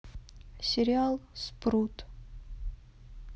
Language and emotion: Russian, sad